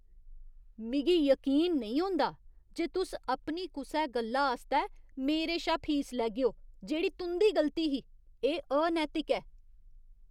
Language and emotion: Dogri, disgusted